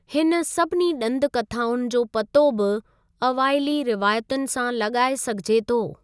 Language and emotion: Sindhi, neutral